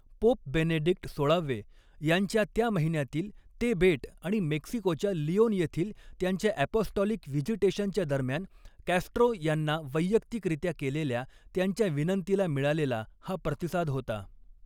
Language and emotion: Marathi, neutral